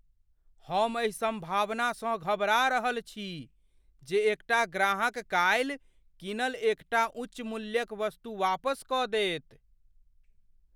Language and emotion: Maithili, fearful